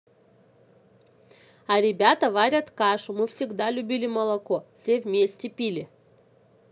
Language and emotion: Russian, positive